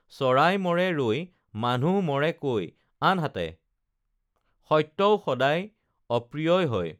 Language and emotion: Assamese, neutral